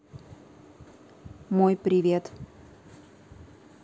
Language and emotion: Russian, neutral